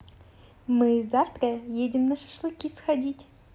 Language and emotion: Russian, positive